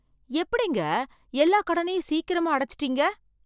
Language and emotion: Tamil, surprised